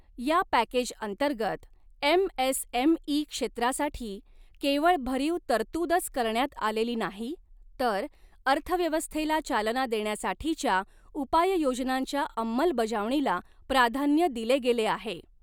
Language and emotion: Marathi, neutral